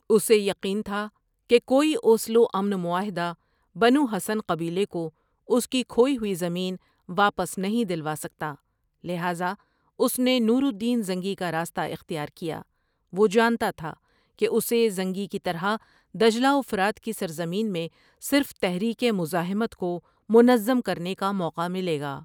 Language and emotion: Urdu, neutral